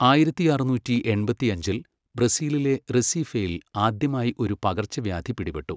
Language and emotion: Malayalam, neutral